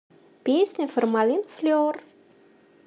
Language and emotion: Russian, positive